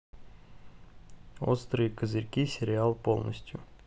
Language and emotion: Russian, neutral